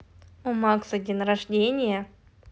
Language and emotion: Russian, positive